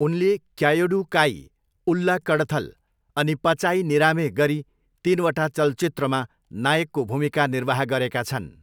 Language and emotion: Nepali, neutral